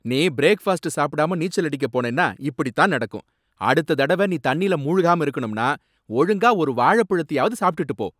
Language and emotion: Tamil, angry